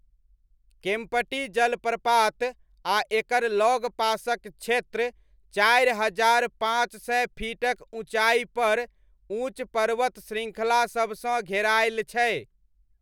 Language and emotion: Maithili, neutral